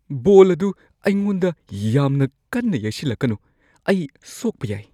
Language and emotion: Manipuri, fearful